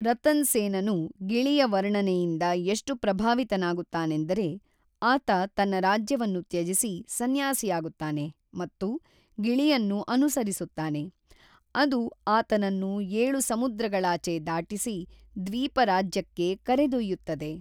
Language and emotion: Kannada, neutral